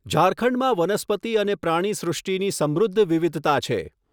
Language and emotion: Gujarati, neutral